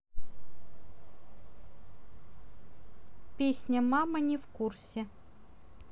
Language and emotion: Russian, neutral